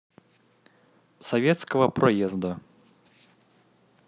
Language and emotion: Russian, neutral